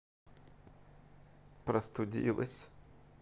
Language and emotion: Russian, sad